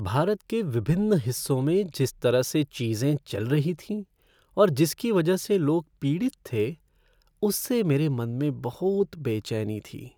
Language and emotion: Hindi, sad